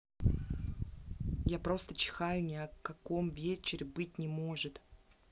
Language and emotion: Russian, angry